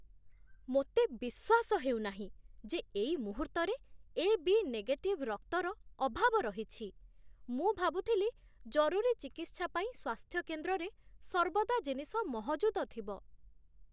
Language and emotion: Odia, surprised